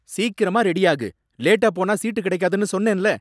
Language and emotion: Tamil, angry